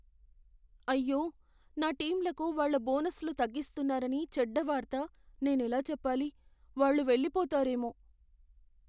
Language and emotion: Telugu, fearful